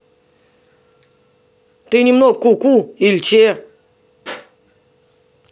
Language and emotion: Russian, angry